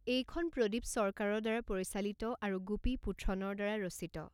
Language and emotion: Assamese, neutral